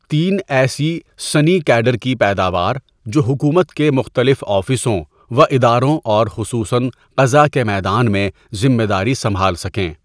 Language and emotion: Urdu, neutral